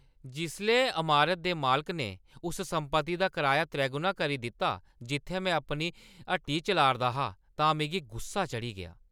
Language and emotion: Dogri, angry